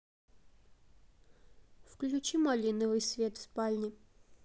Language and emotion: Russian, neutral